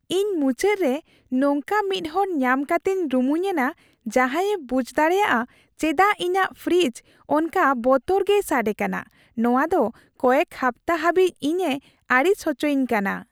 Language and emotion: Santali, happy